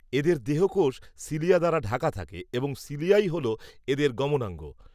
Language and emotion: Bengali, neutral